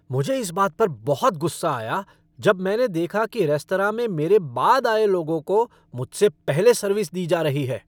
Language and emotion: Hindi, angry